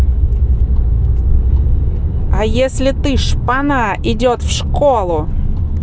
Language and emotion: Russian, angry